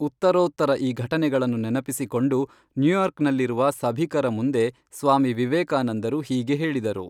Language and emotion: Kannada, neutral